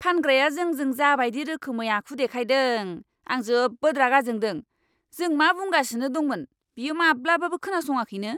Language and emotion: Bodo, angry